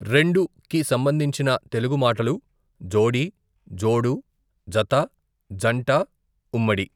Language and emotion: Telugu, neutral